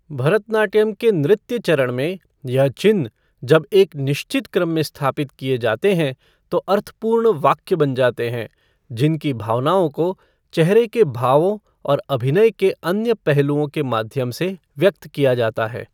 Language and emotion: Hindi, neutral